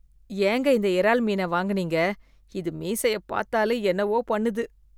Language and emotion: Tamil, disgusted